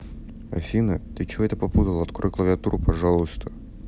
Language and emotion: Russian, neutral